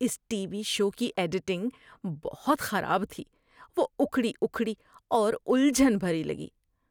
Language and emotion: Urdu, disgusted